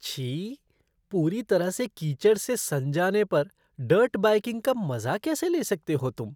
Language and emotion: Hindi, disgusted